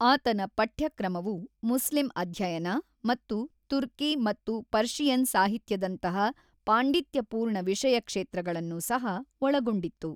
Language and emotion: Kannada, neutral